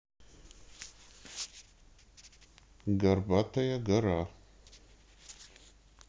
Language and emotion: Russian, neutral